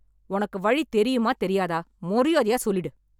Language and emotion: Tamil, angry